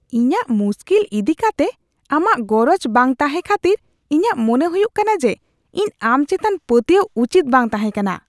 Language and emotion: Santali, disgusted